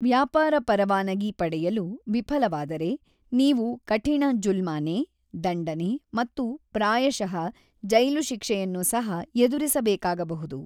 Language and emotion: Kannada, neutral